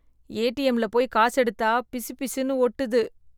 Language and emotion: Tamil, disgusted